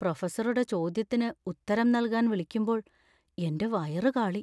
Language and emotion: Malayalam, fearful